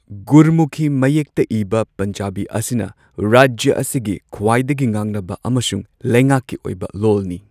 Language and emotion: Manipuri, neutral